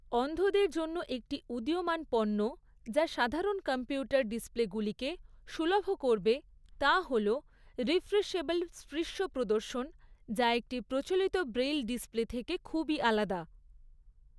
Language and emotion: Bengali, neutral